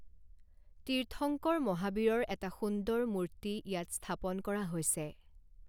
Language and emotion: Assamese, neutral